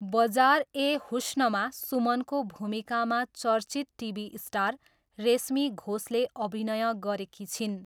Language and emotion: Nepali, neutral